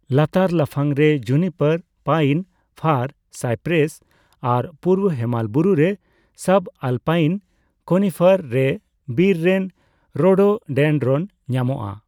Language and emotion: Santali, neutral